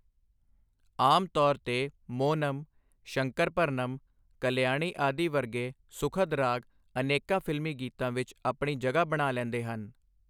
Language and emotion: Punjabi, neutral